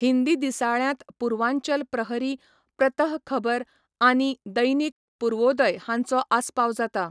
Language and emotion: Goan Konkani, neutral